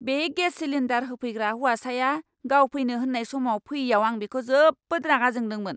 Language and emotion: Bodo, angry